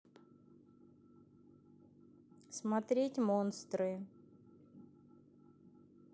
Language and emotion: Russian, neutral